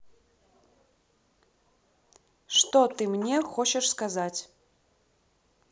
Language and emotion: Russian, neutral